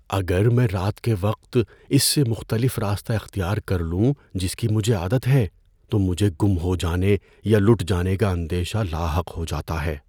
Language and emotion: Urdu, fearful